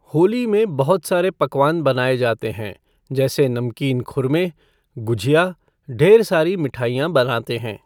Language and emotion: Hindi, neutral